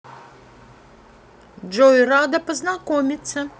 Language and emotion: Russian, neutral